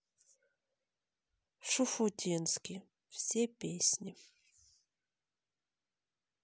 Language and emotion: Russian, sad